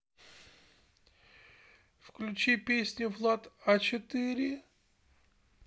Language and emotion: Russian, sad